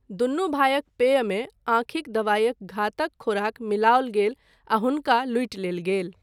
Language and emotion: Maithili, neutral